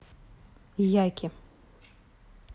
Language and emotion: Russian, neutral